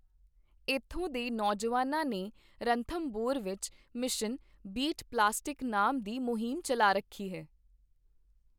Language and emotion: Punjabi, neutral